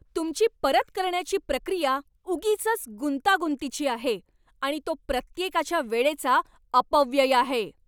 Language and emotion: Marathi, angry